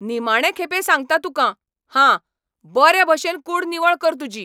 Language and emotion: Goan Konkani, angry